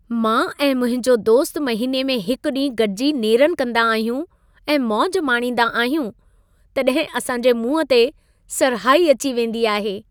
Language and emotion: Sindhi, happy